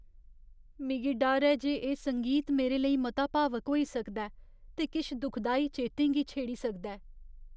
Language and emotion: Dogri, fearful